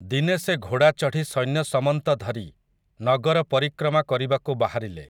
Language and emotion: Odia, neutral